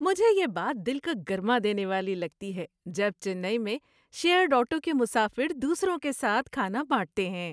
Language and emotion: Urdu, happy